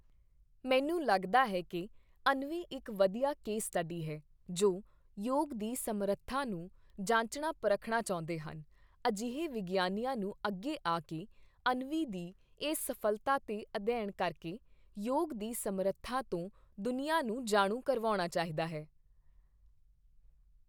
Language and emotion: Punjabi, neutral